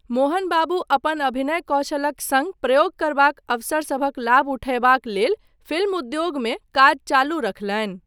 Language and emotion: Maithili, neutral